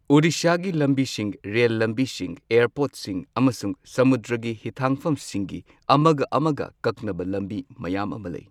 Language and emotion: Manipuri, neutral